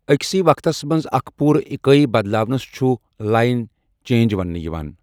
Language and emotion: Kashmiri, neutral